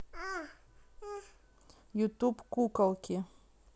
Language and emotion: Russian, neutral